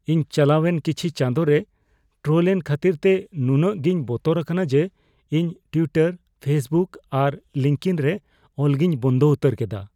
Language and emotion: Santali, fearful